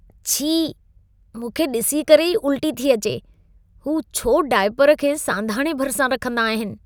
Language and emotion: Sindhi, disgusted